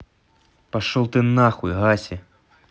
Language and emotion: Russian, angry